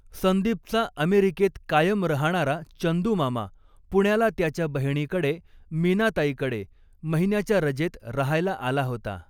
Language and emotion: Marathi, neutral